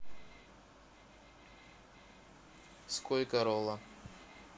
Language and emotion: Russian, neutral